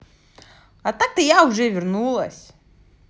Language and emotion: Russian, positive